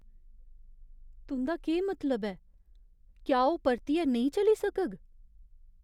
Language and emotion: Dogri, fearful